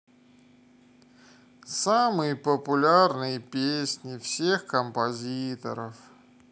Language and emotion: Russian, sad